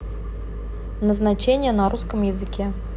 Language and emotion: Russian, neutral